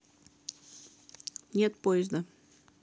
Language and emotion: Russian, neutral